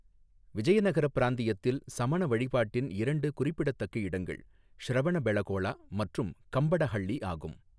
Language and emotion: Tamil, neutral